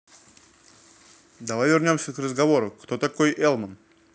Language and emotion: Russian, neutral